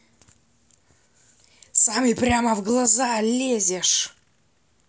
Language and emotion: Russian, angry